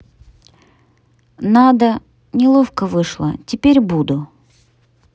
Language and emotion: Russian, neutral